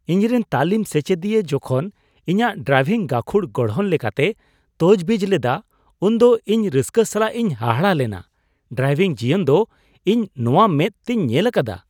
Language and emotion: Santali, surprised